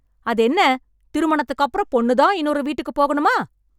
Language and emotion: Tamil, angry